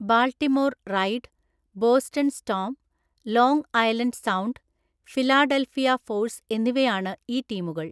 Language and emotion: Malayalam, neutral